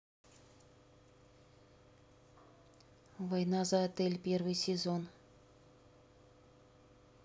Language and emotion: Russian, neutral